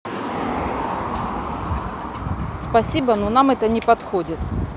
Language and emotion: Russian, neutral